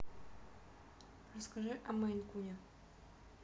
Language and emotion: Russian, neutral